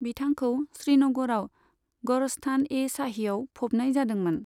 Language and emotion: Bodo, neutral